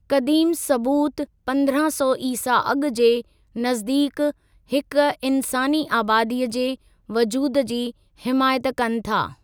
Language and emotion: Sindhi, neutral